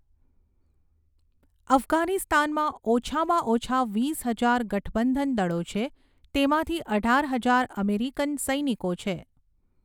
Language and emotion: Gujarati, neutral